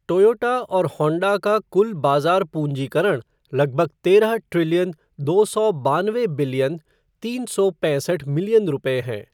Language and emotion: Hindi, neutral